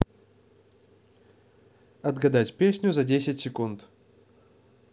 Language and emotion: Russian, positive